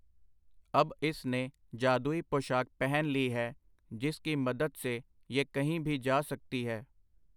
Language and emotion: Punjabi, neutral